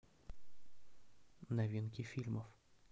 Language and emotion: Russian, neutral